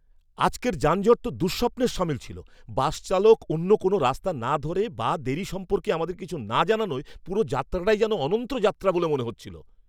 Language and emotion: Bengali, angry